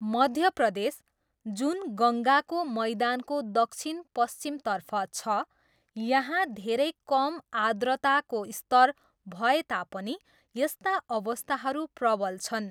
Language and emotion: Nepali, neutral